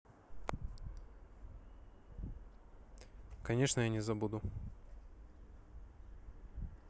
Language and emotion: Russian, neutral